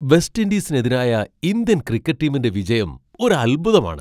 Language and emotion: Malayalam, surprised